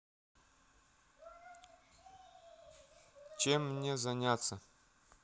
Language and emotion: Russian, sad